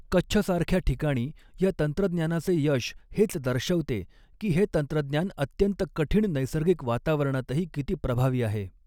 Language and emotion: Marathi, neutral